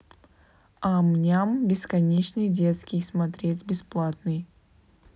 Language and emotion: Russian, neutral